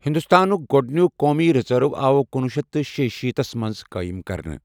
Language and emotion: Kashmiri, neutral